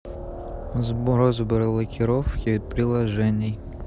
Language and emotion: Russian, neutral